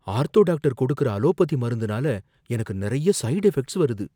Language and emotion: Tamil, fearful